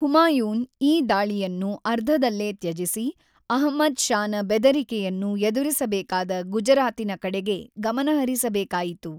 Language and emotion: Kannada, neutral